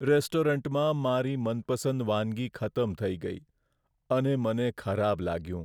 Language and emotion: Gujarati, sad